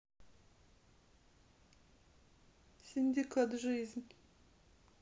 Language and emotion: Russian, sad